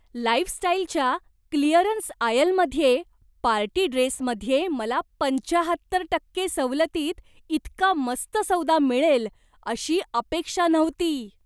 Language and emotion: Marathi, surprised